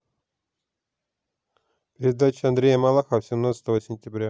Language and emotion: Russian, neutral